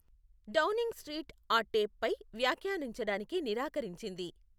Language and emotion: Telugu, neutral